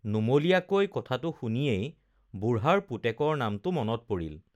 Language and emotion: Assamese, neutral